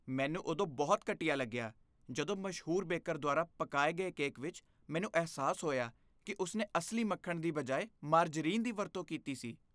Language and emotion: Punjabi, disgusted